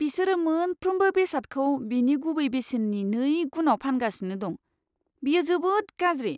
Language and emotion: Bodo, disgusted